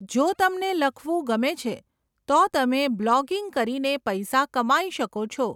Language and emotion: Gujarati, neutral